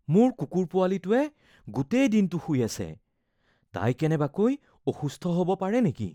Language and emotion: Assamese, fearful